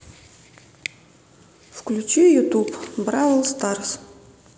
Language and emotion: Russian, neutral